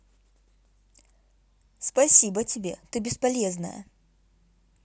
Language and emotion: Russian, angry